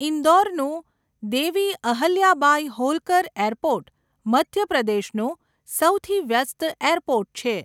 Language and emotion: Gujarati, neutral